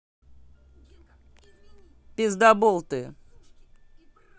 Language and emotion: Russian, angry